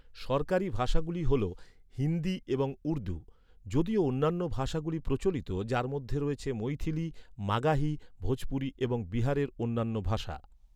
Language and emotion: Bengali, neutral